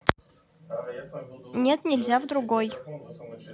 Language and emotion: Russian, neutral